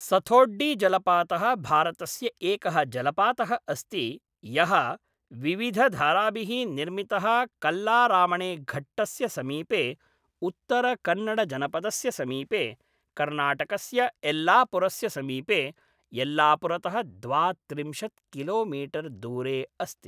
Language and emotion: Sanskrit, neutral